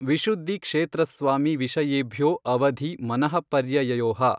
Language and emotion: Kannada, neutral